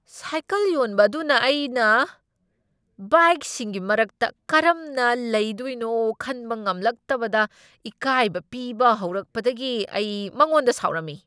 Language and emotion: Manipuri, angry